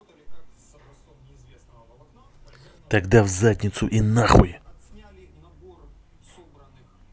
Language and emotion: Russian, angry